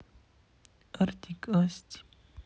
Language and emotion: Russian, sad